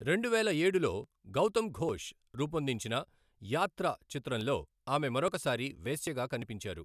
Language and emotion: Telugu, neutral